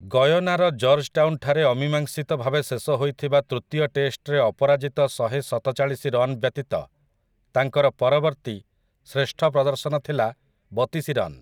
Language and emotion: Odia, neutral